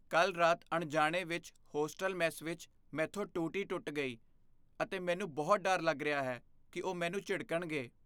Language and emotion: Punjabi, fearful